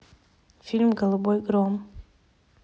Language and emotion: Russian, neutral